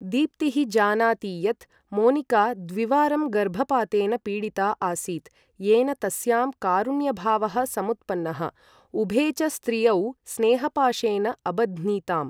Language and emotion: Sanskrit, neutral